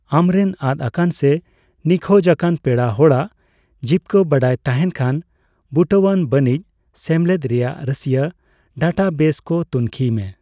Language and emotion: Santali, neutral